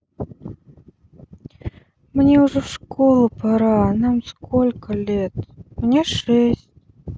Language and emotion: Russian, sad